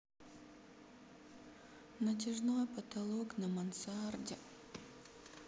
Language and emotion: Russian, sad